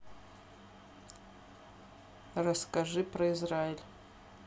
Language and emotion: Russian, neutral